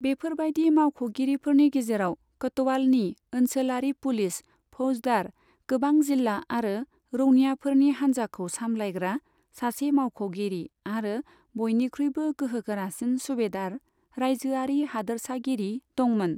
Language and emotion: Bodo, neutral